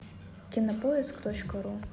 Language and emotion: Russian, neutral